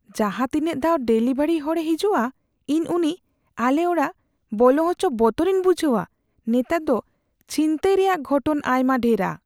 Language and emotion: Santali, fearful